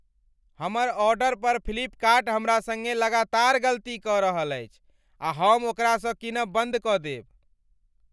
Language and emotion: Maithili, angry